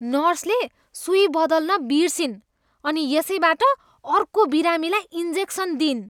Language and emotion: Nepali, disgusted